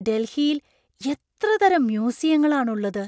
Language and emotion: Malayalam, surprised